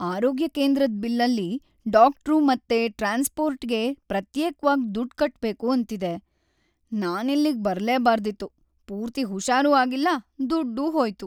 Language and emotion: Kannada, sad